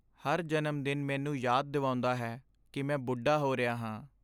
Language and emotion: Punjabi, sad